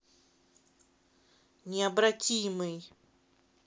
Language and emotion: Russian, neutral